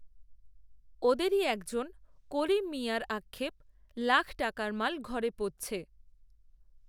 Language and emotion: Bengali, neutral